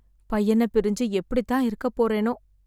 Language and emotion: Tamil, sad